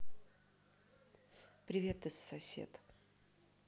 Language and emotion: Russian, neutral